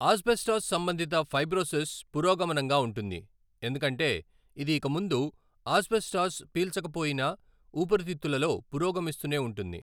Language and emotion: Telugu, neutral